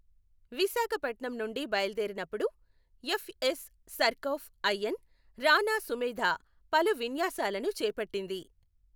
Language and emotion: Telugu, neutral